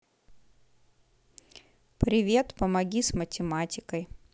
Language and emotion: Russian, neutral